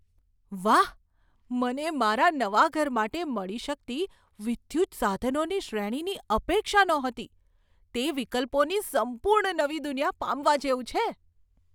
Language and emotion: Gujarati, surprised